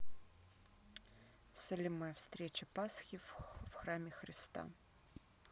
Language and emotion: Russian, neutral